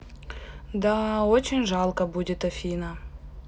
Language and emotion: Russian, sad